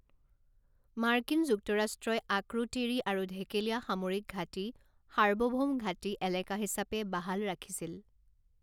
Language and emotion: Assamese, neutral